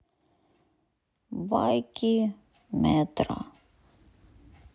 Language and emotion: Russian, sad